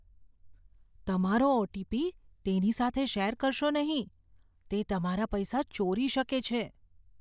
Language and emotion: Gujarati, fearful